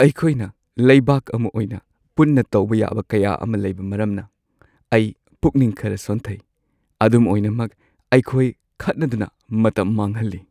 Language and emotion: Manipuri, sad